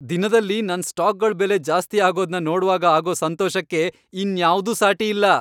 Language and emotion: Kannada, happy